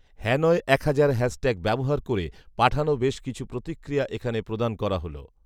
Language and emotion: Bengali, neutral